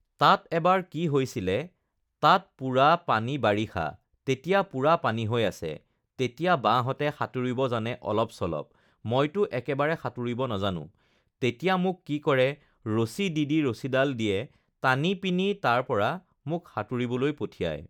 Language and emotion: Assamese, neutral